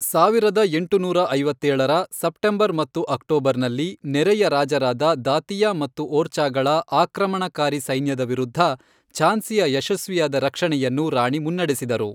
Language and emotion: Kannada, neutral